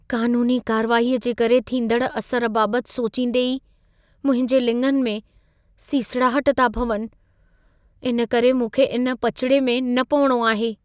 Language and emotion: Sindhi, fearful